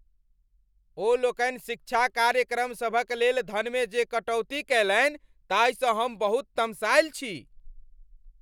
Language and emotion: Maithili, angry